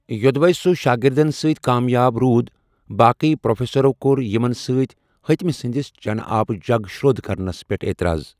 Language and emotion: Kashmiri, neutral